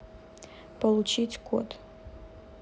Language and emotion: Russian, neutral